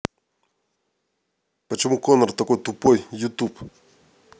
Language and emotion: Russian, angry